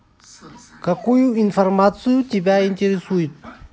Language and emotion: Russian, neutral